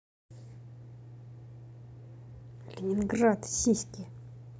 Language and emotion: Russian, angry